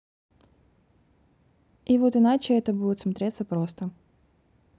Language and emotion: Russian, neutral